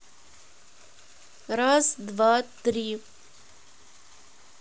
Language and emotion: Russian, neutral